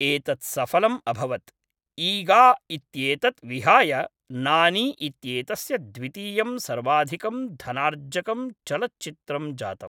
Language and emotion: Sanskrit, neutral